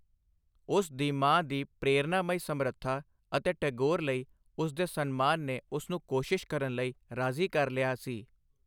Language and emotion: Punjabi, neutral